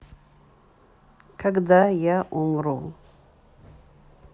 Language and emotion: Russian, neutral